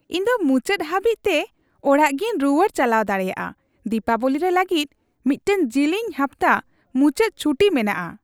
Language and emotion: Santali, happy